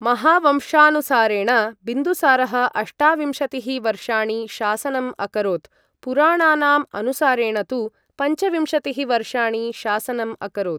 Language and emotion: Sanskrit, neutral